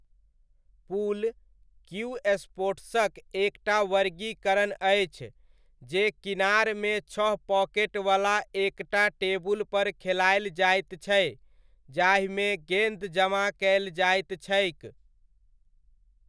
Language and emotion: Maithili, neutral